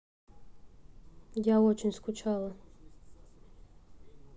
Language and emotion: Russian, sad